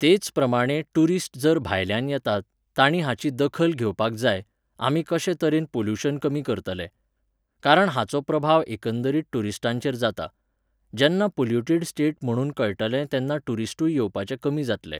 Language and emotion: Goan Konkani, neutral